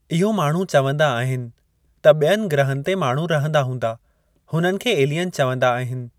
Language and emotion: Sindhi, neutral